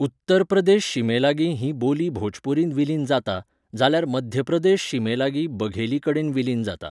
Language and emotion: Goan Konkani, neutral